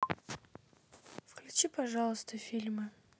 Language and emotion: Russian, neutral